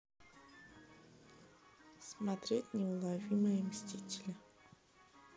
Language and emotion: Russian, neutral